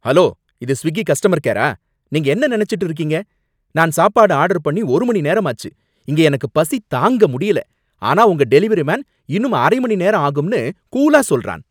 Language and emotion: Tamil, angry